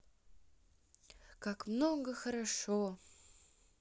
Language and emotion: Russian, neutral